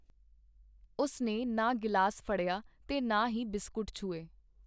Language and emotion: Punjabi, neutral